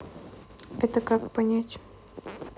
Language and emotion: Russian, neutral